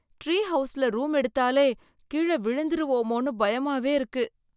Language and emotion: Tamil, fearful